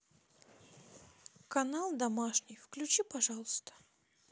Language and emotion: Russian, neutral